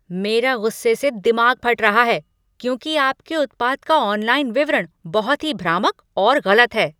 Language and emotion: Hindi, angry